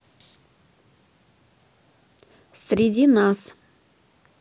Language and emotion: Russian, neutral